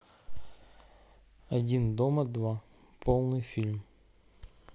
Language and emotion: Russian, neutral